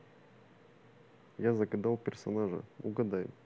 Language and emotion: Russian, neutral